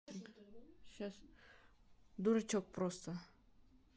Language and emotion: Russian, neutral